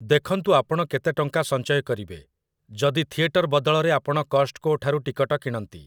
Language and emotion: Odia, neutral